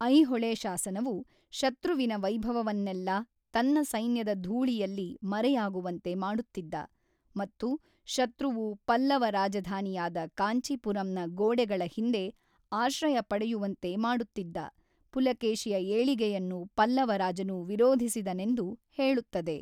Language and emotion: Kannada, neutral